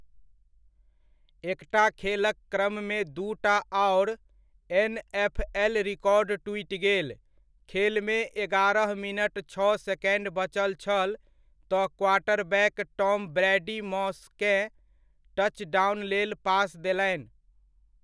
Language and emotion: Maithili, neutral